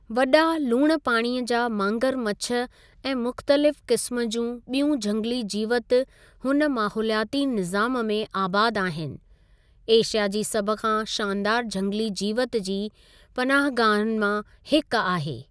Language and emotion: Sindhi, neutral